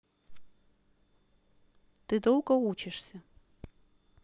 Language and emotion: Russian, neutral